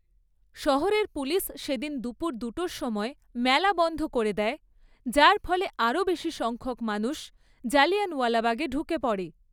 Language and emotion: Bengali, neutral